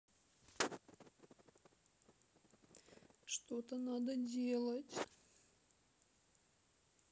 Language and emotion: Russian, sad